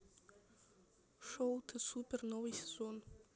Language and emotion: Russian, neutral